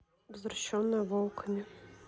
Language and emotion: Russian, neutral